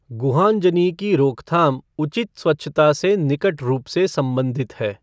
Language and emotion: Hindi, neutral